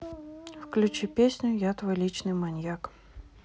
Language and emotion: Russian, neutral